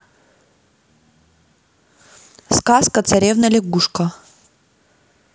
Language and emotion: Russian, neutral